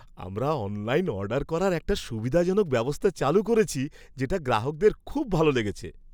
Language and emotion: Bengali, happy